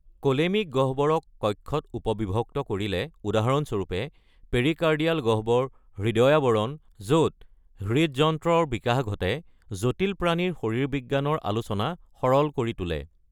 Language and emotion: Assamese, neutral